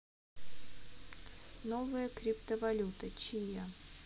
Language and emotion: Russian, neutral